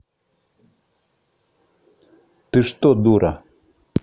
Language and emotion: Russian, angry